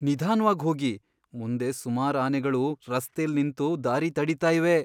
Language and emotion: Kannada, fearful